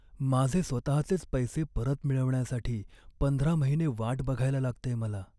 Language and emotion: Marathi, sad